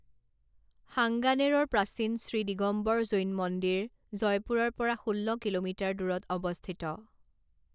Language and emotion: Assamese, neutral